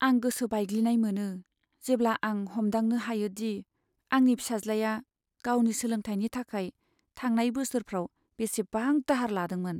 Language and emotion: Bodo, sad